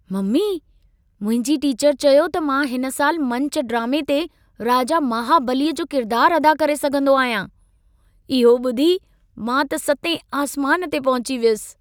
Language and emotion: Sindhi, happy